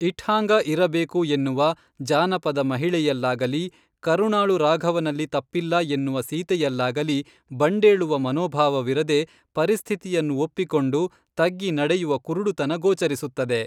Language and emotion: Kannada, neutral